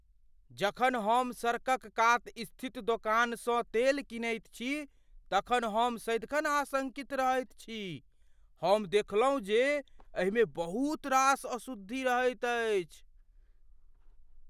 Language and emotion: Maithili, fearful